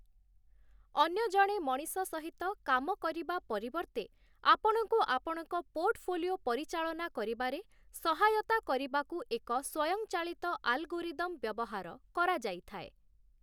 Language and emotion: Odia, neutral